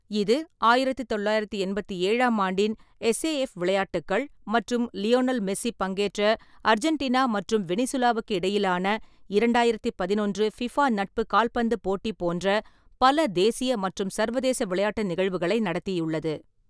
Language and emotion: Tamil, neutral